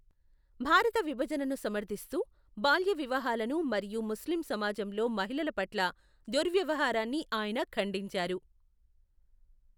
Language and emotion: Telugu, neutral